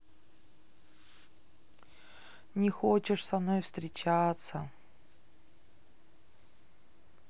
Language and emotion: Russian, sad